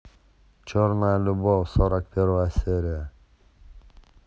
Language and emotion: Russian, neutral